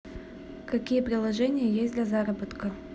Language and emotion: Russian, neutral